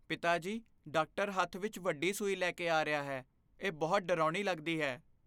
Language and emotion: Punjabi, fearful